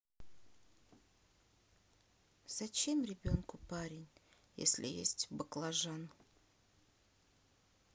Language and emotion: Russian, sad